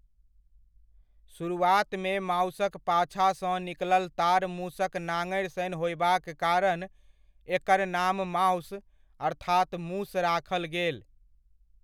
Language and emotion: Maithili, neutral